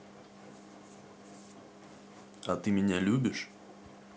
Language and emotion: Russian, neutral